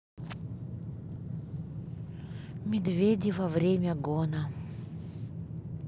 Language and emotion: Russian, sad